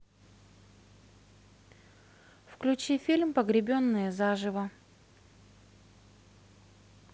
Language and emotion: Russian, neutral